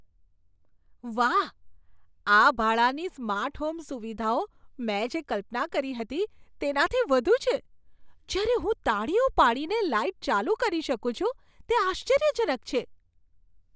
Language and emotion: Gujarati, surprised